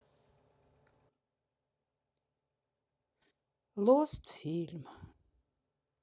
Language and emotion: Russian, sad